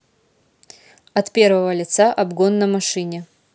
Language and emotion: Russian, neutral